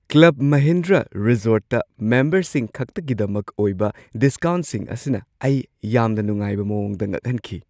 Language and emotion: Manipuri, surprised